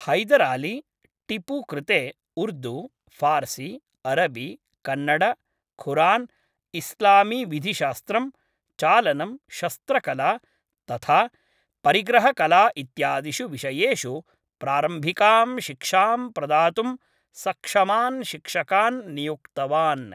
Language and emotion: Sanskrit, neutral